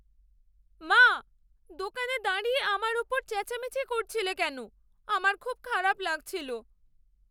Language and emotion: Bengali, sad